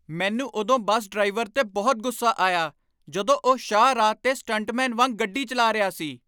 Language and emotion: Punjabi, angry